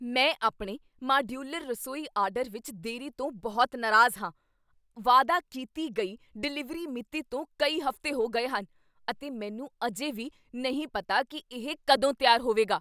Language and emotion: Punjabi, angry